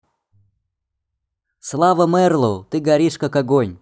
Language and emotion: Russian, neutral